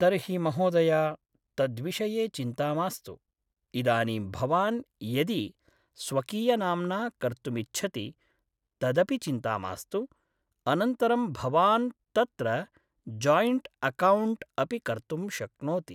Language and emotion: Sanskrit, neutral